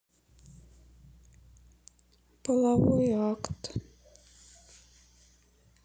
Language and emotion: Russian, sad